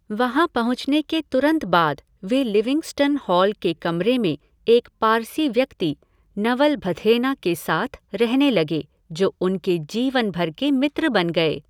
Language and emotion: Hindi, neutral